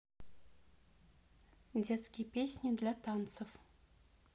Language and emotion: Russian, neutral